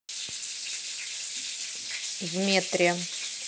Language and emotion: Russian, neutral